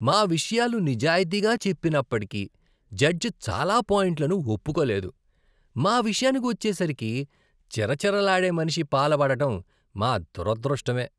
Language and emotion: Telugu, disgusted